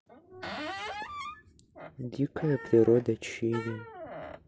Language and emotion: Russian, neutral